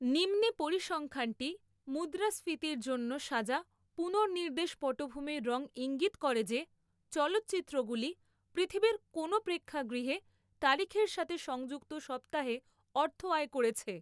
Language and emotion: Bengali, neutral